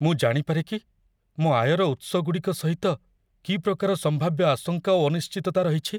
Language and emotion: Odia, fearful